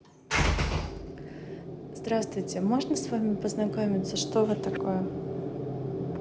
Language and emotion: Russian, neutral